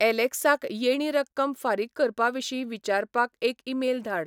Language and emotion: Goan Konkani, neutral